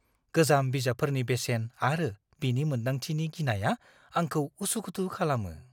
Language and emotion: Bodo, fearful